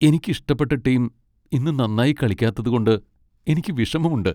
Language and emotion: Malayalam, sad